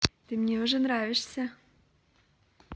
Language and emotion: Russian, positive